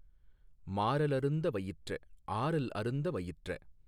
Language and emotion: Tamil, neutral